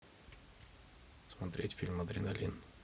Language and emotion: Russian, neutral